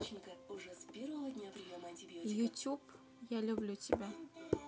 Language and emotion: Russian, neutral